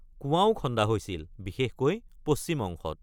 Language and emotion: Assamese, neutral